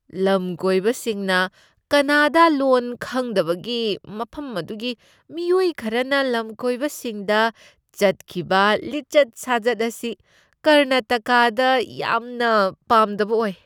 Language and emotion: Manipuri, disgusted